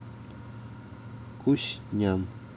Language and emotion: Russian, neutral